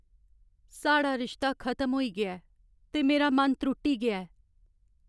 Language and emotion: Dogri, sad